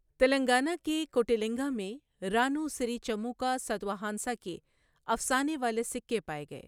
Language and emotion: Urdu, neutral